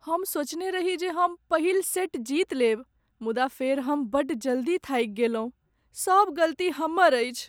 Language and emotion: Maithili, sad